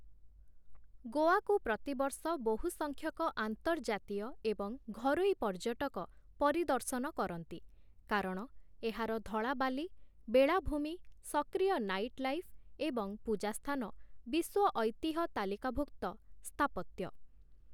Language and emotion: Odia, neutral